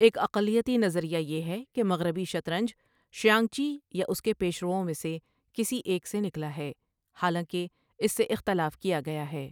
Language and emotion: Urdu, neutral